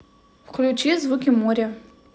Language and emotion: Russian, neutral